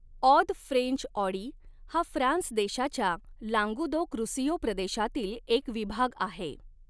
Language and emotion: Marathi, neutral